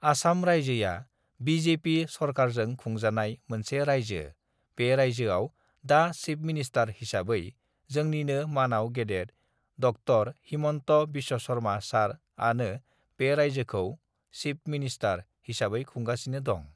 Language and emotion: Bodo, neutral